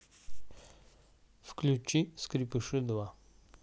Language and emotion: Russian, neutral